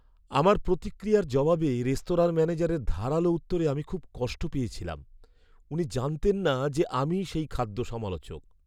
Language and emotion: Bengali, sad